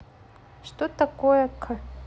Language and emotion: Russian, neutral